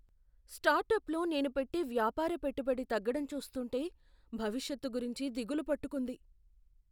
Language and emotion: Telugu, fearful